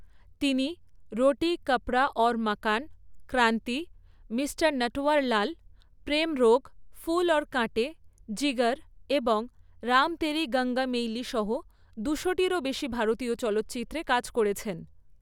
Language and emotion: Bengali, neutral